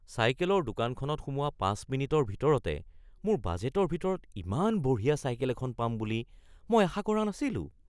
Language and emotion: Assamese, surprised